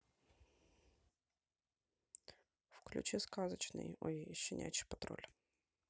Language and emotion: Russian, neutral